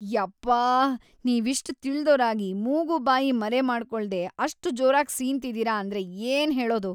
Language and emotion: Kannada, disgusted